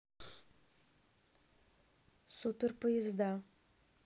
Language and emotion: Russian, neutral